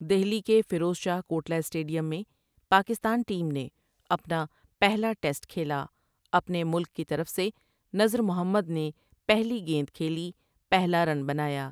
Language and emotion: Urdu, neutral